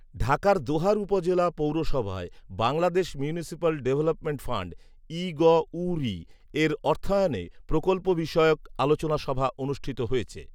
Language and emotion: Bengali, neutral